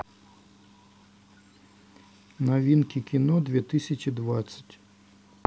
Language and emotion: Russian, neutral